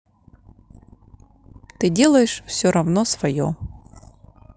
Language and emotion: Russian, neutral